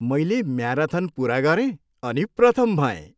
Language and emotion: Nepali, happy